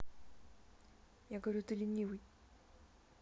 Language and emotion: Russian, neutral